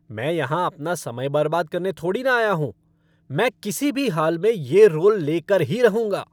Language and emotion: Hindi, angry